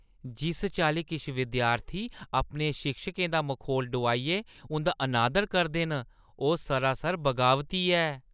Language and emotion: Dogri, disgusted